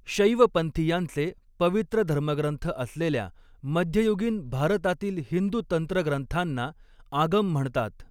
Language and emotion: Marathi, neutral